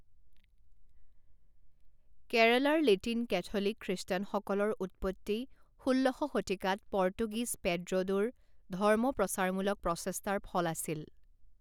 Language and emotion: Assamese, neutral